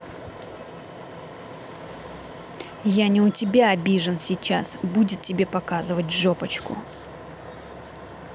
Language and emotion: Russian, angry